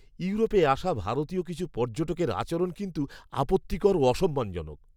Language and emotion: Bengali, disgusted